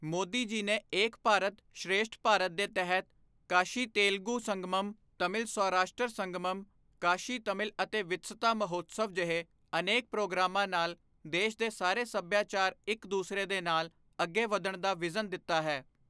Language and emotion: Punjabi, neutral